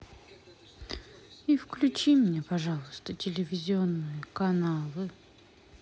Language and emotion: Russian, sad